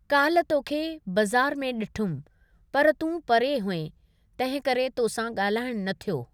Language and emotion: Sindhi, neutral